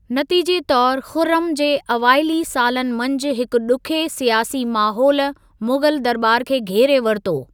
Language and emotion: Sindhi, neutral